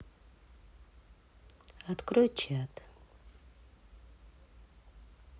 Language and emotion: Russian, neutral